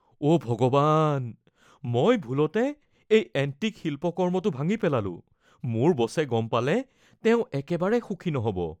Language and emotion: Assamese, fearful